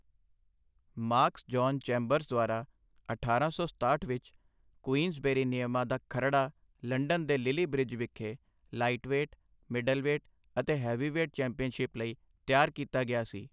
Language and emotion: Punjabi, neutral